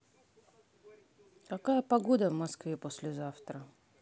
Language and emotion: Russian, neutral